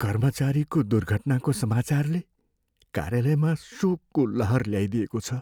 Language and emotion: Nepali, sad